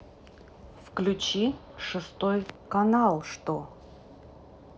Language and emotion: Russian, neutral